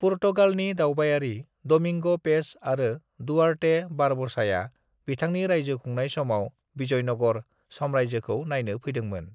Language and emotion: Bodo, neutral